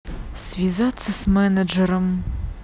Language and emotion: Russian, neutral